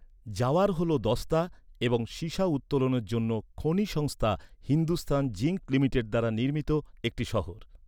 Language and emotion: Bengali, neutral